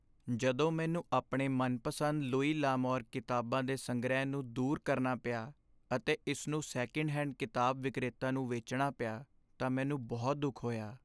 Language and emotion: Punjabi, sad